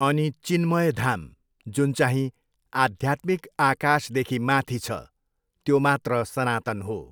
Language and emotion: Nepali, neutral